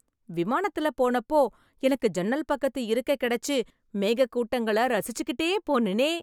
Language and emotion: Tamil, happy